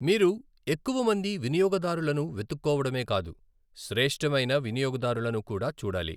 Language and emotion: Telugu, neutral